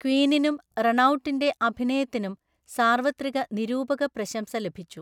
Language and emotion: Malayalam, neutral